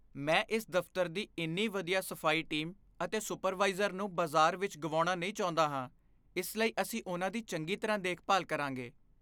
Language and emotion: Punjabi, fearful